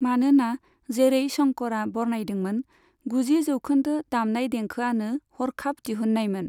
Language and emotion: Bodo, neutral